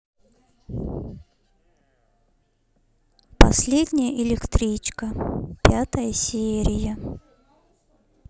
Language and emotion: Russian, neutral